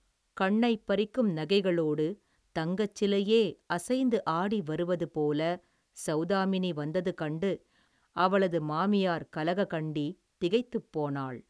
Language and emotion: Tamil, neutral